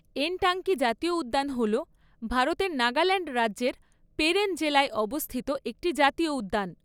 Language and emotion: Bengali, neutral